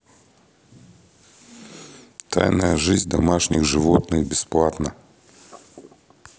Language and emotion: Russian, neutral